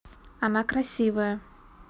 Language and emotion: Russian, neutral